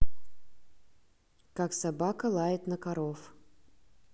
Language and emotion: Russian, neutral